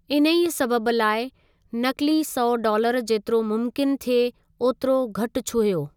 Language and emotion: Sindhi, neutral